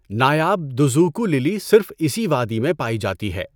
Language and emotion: Urdu, neutral